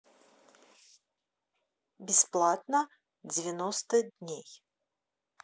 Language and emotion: Russian, neutral